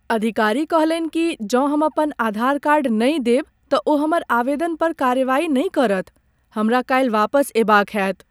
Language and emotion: Maithili, sad